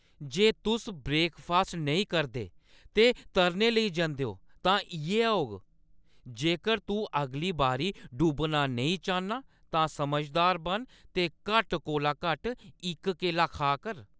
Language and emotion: Dogri, angry